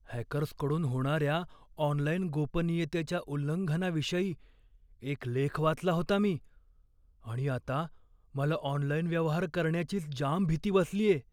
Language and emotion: Marathi, fearful